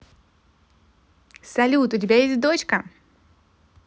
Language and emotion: Russian, positive